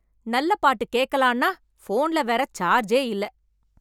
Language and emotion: Tamil, angry